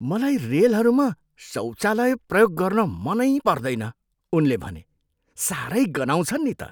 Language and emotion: Nepali, disgusted